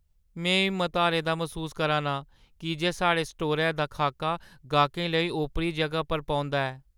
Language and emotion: Dogri, sad